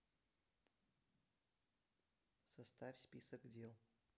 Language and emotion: Russian, neutral